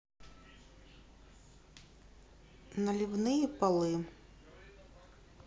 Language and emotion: Russian, neutral